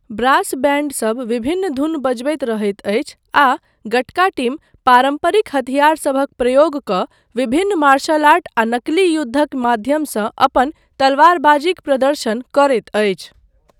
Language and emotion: Maithili, neutral